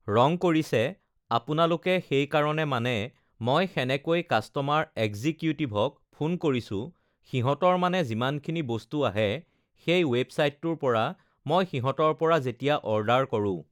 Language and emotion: Assamese, neutral